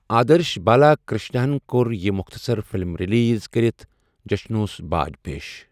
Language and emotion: Kashmiri, neutral